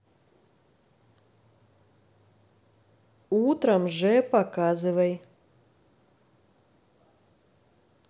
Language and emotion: Russian, neutral